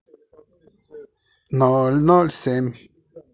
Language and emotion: Russian, positive